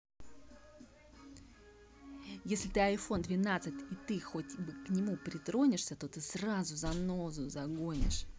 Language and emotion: Russian, angry